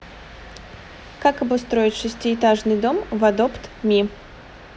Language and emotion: Russian, neutral